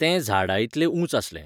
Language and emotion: Goan Konkani, neutral